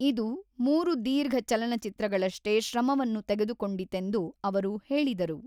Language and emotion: Kannada, neutral